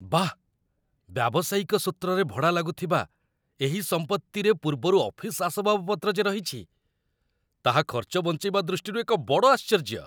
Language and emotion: Odia, surprised